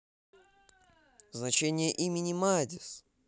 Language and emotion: Russian, positive